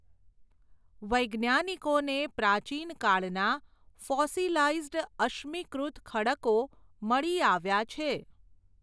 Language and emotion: Gujarati, neutral